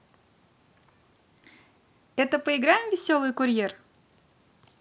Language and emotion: Russian, positive